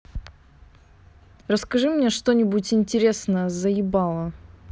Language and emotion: Russian, angry